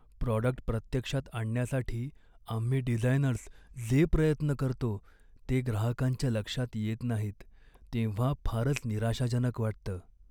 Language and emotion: Marathi, sad